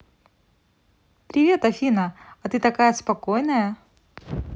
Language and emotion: Russian, positive